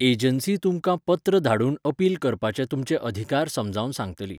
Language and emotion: Goan Konkani, neutral